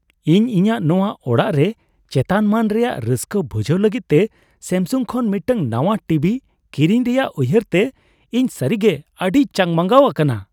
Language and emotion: Santali, happy